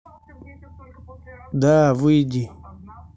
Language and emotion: Russian, angry